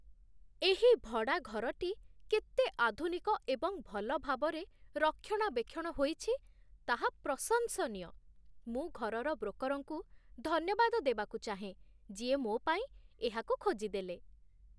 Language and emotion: Odia, surprised